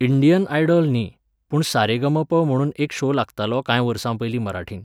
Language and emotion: Goan Konkani, neutral